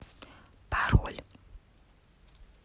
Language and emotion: Russian, neutral